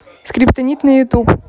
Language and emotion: Russian, neutral